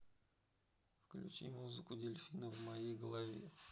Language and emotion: Russian, neutral